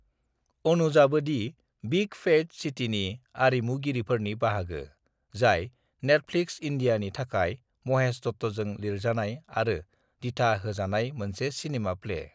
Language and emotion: Bodo, neutral